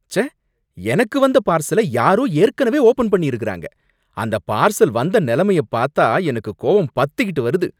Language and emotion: Tamil, angry